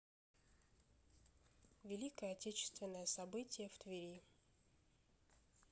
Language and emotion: Russian, neutral